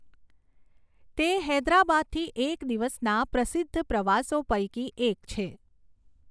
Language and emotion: Gujarati, neutral